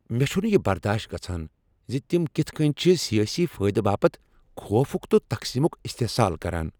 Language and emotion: Kashmiri, angry